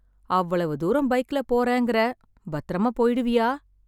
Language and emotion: Tamil, sad